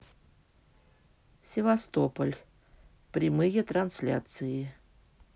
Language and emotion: Russian, neutral